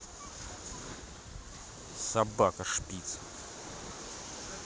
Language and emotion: Russian, angry